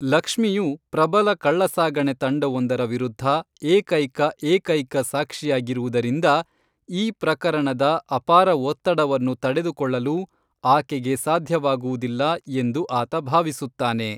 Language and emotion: Kannada, neutral